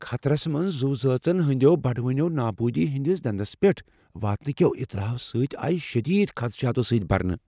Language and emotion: Kashmiri, fearful